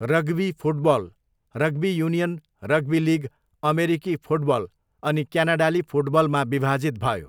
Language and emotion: Nepali, neutral